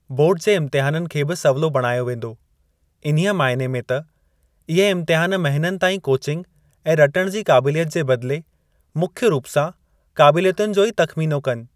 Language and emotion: Sindhi, neutral